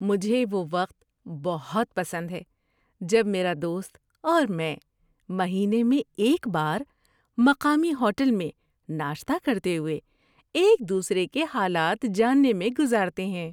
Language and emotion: Urdu, happy